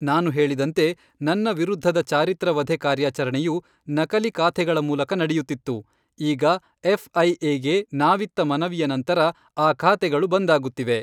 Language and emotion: Kannada, neutral